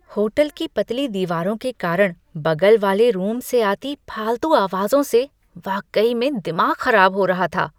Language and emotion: Hindi, disgusted